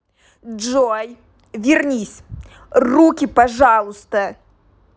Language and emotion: Russian, angry